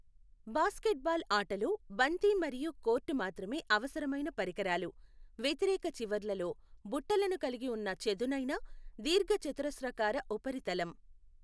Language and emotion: Telugu, neutral